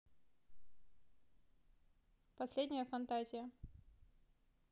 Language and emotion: Russian, neutral